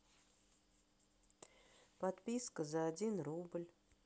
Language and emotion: Russian, sad